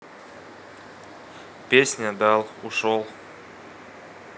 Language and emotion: Russian, neutral